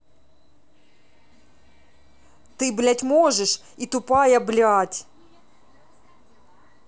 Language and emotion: Russian, angry